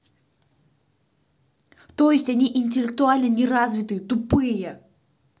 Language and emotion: Russian, angry